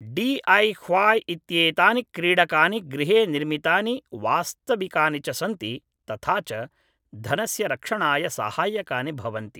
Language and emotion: Sanskrit, neutral